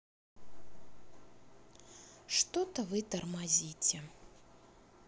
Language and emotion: Russian, sad